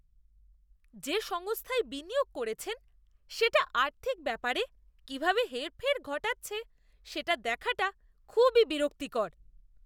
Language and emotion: Bengali, disgusted